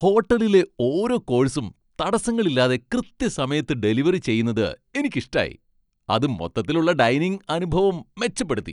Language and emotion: Malayalam, happy